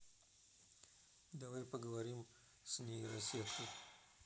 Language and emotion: Russian, neutral